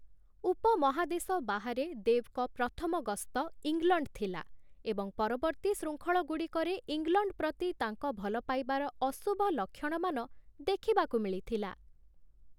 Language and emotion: Odia, neutral